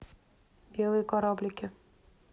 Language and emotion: Russian, neutral